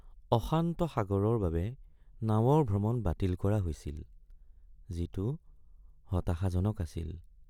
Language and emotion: Assamese, sad